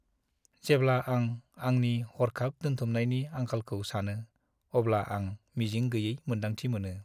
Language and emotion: Bodo, sad